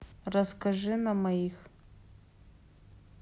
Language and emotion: Russian, neutral